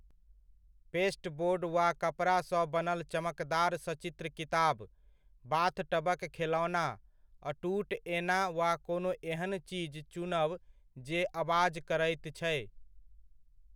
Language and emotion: Maithili, neutral